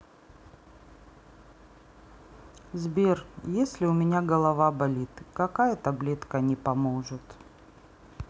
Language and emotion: Russian, sad